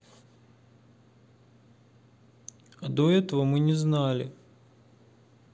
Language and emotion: Russian, sad